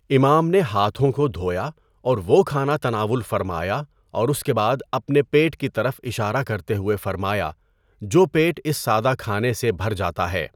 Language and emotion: Urdu, neutral